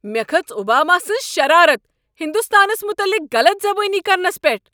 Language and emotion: Kashmiri, angry